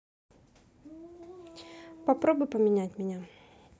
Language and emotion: Russian, neutral